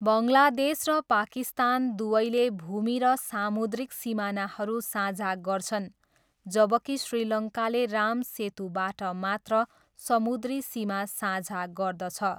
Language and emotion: Nepali, neutral